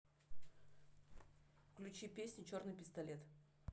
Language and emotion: Russian, neutral